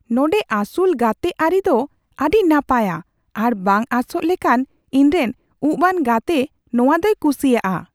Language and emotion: Santali, surprised